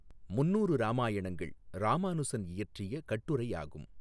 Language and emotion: Tamil, neutral